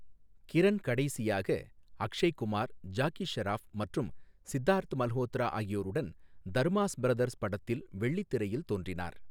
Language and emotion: Tamil, neutral